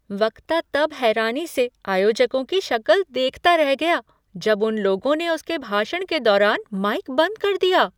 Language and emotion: Hindi, surprised